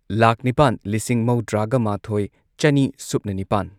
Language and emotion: Manipuri, neutral